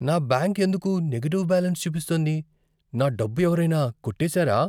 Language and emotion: Telugu, fearful